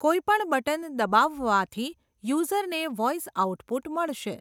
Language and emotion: Gujarati, neutral